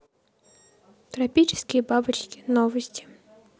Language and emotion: Russian, neutral